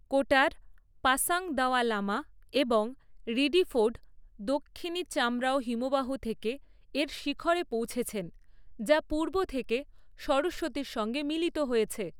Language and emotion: Bengali, neutral